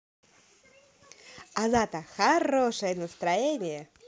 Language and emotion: Russian, positive